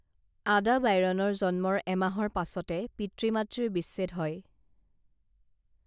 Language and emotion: Assamese, neutral